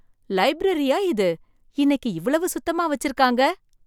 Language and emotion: Tamil, surprised